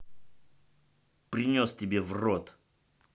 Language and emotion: Russian, angry